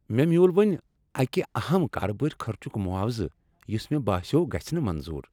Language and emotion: Kashmiri, happy